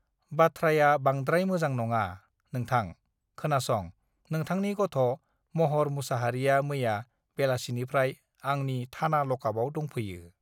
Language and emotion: Bodo, neutral